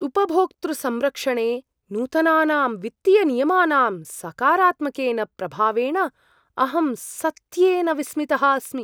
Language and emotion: Sanskrit, surprised